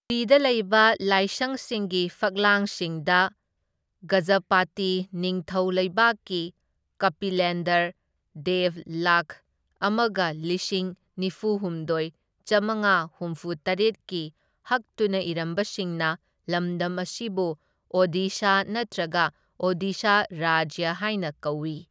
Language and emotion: Manipuri, neutral